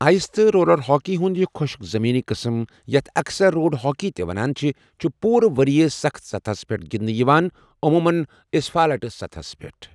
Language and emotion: Kashmiri, neutral